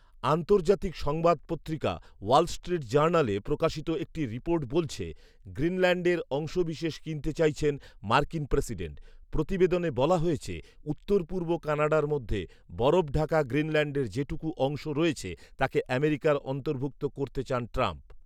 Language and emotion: Bengali, neutral